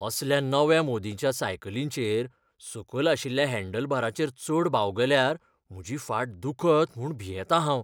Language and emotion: Goan Konkani, fearful